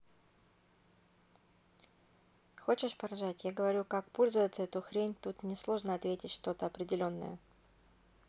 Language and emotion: Russian, neutral